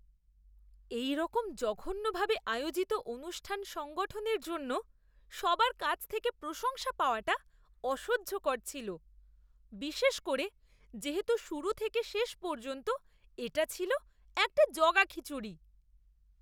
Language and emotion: Bengali, disgusted